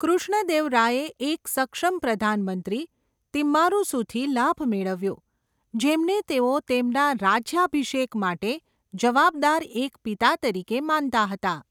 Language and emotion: Gujarati, neutral